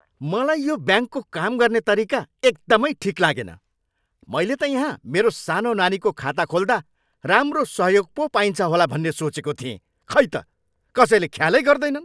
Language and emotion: Nepali, angry